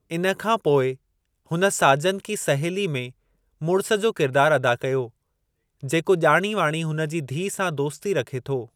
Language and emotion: Sindhi, neutral